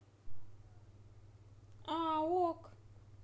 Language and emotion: Russian, neutral